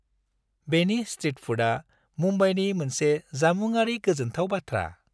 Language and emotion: Bodo, happy